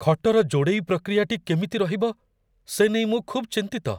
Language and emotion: Odia, fearful